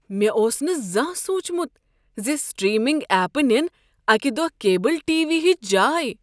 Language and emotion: Kashmiri, surprised